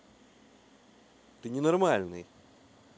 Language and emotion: Russian, angry